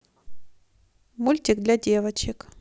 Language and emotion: Russian, neutral